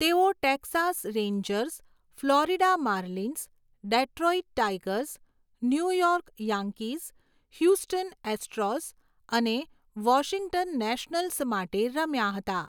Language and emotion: Gujarati, neutral